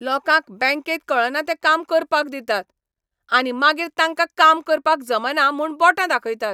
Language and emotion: Goan Konkani, angry